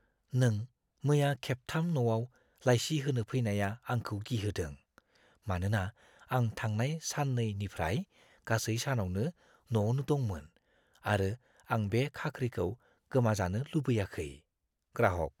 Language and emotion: Bodo, fearful